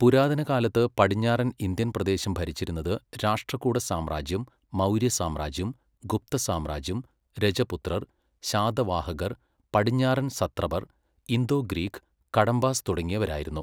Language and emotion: Malayalam, neutral